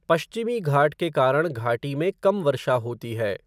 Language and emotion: Hindi, neutral